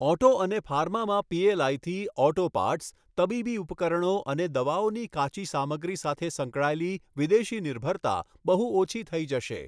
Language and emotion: Gujarati, neutral